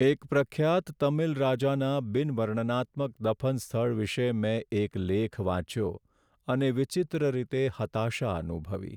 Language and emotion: Gujarati, sad